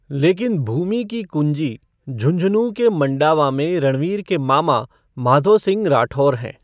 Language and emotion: Hindi, neutral